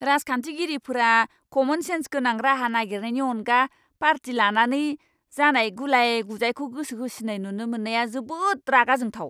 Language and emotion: Bodo, angry